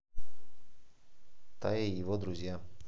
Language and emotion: Russian, neutral